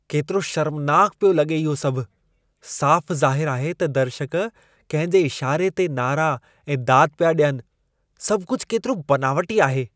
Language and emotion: Sindhi, disgusted